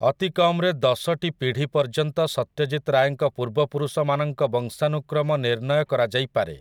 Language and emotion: Odia, neutral